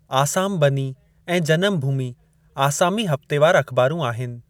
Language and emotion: Sindhi, neutral